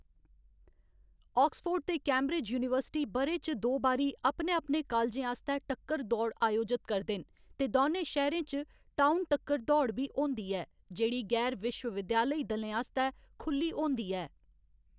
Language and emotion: Dogri, neutral